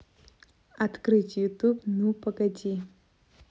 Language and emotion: Russian, neutral